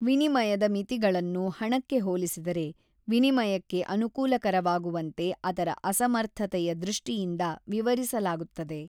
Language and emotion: Kannada, neutral